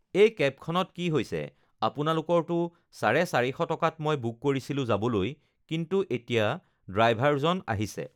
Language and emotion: Assamese, neutral